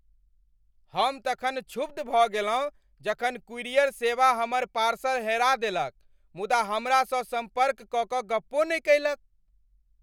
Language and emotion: Maithili, angry